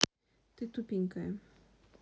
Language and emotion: Russian, neutral